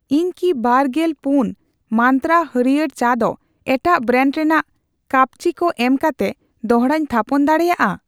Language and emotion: Santali, neutral